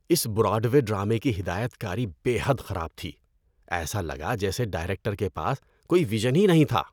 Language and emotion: Urdu, disgusted